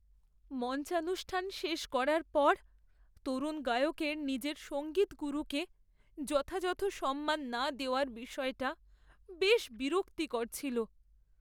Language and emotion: Bengali, sad